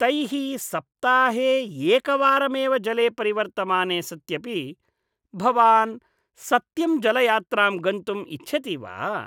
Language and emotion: Sanskrit, disgusted